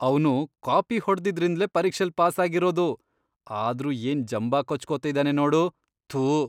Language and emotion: Kannada, disgusted